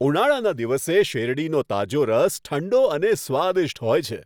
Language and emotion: Gujarati, happy